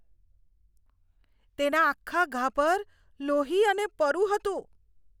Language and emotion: Gujarati, disgusted